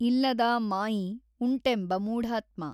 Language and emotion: Kannada, neutral